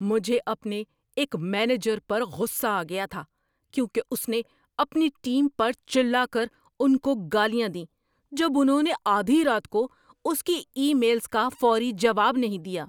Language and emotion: Urdu, angry